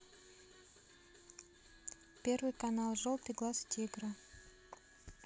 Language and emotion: Russian, neutral